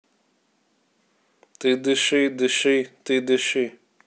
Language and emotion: Russian, neutral